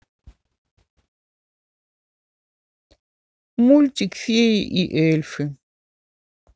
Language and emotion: Russian, sad